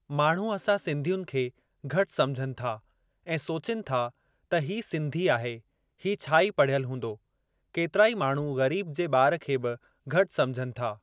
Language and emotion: Sindhi, neutral